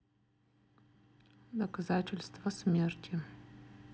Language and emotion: Russian, neutral